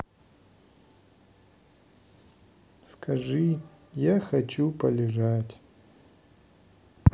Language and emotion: Russian, neutral